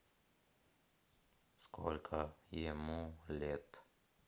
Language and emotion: Russian, neutral